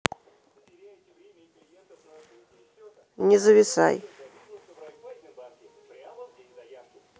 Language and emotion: Russian, neutral